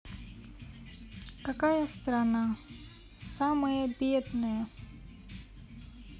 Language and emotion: Russian, sad